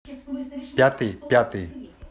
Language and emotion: Russian, neutral